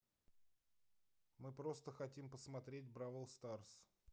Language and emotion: Russian, neutral